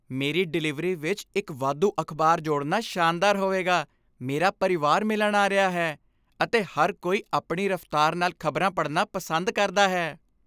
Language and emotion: Punjabi, happy